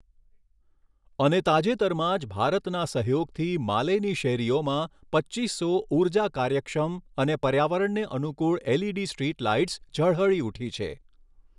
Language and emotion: Gujarati, neutral